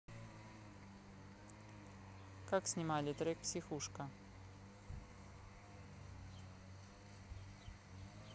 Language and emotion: Russian, neutral